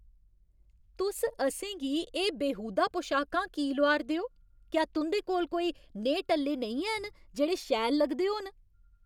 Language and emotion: Dogri, angry